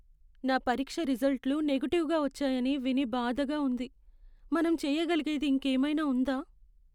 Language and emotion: Telugu, sad